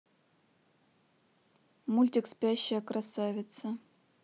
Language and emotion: Russian, neutral